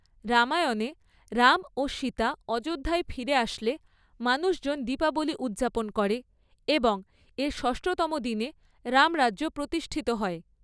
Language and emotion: Bengali, neutral